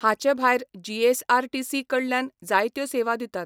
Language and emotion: Goan Konkani, neutral